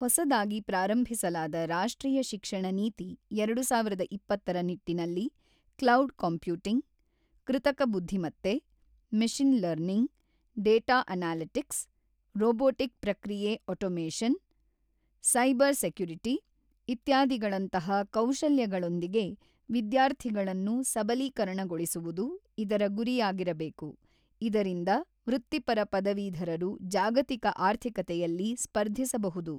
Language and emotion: Kannada, neutral